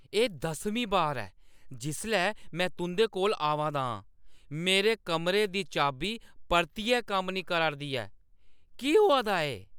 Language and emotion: Dogri, angry